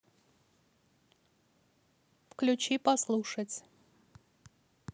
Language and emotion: Russian, neutral